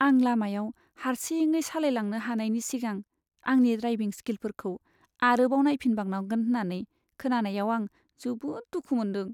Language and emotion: Bodo, sad